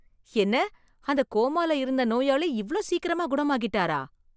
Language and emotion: Tamil, surprised